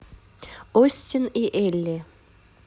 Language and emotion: Russian, positive